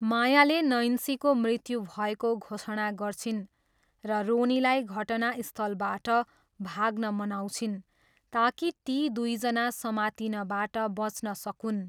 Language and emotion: Nepali, neutral